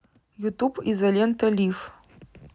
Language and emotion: Russian, neutral